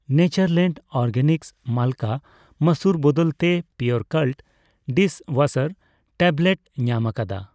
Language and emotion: Santali, neutral